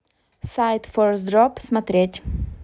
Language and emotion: Russian, neutral